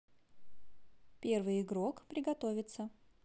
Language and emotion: Russian, positive